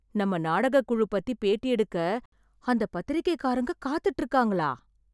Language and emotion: Tamil, surprised